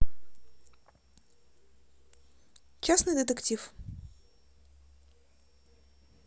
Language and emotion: Russian, neutral